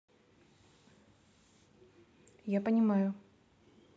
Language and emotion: Russian, neutral